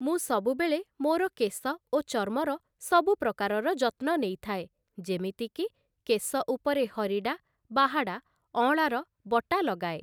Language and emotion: Odia, neutral